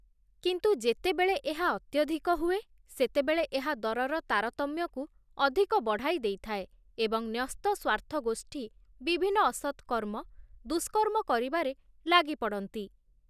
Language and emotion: Odia, neutral